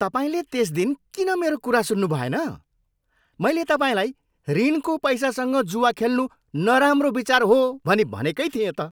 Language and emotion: Nepali, angry